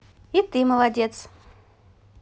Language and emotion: Russian, positive